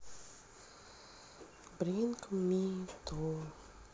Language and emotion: Russian, sad